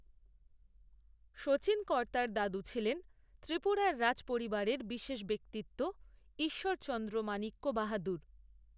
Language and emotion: Bengali, neutral